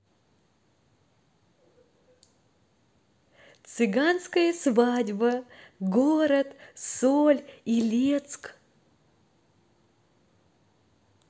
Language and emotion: Russian, positive